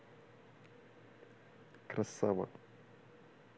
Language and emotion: Russian, positive